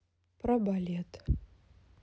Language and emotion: Russian, sad